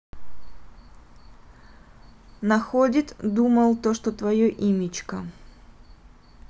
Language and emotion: Russian, neutral